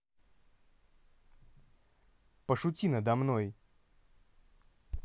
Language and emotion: Russian, angry